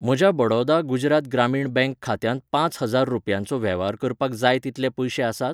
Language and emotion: Goan Konkani, neutral